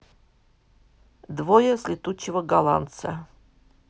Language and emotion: Russian, neutral